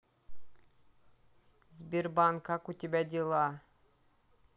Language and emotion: Russian, neutral